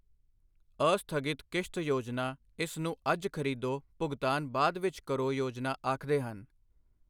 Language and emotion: Punjabi, neutral